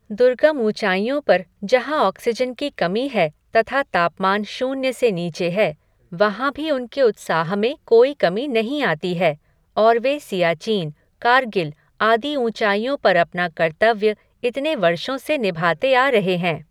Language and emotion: Hindi, neutral